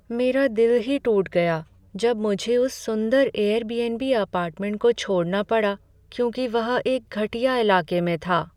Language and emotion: Hindi, sad